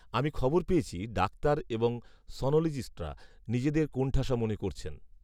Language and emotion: Bengali, neutral